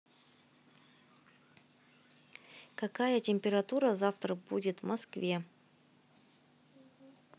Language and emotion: Russian, neutral